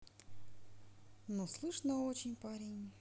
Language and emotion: Russian, sad